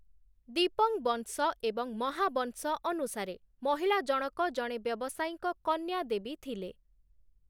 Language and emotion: Odia, neutral